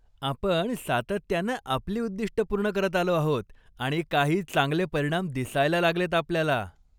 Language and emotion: Marathi, happy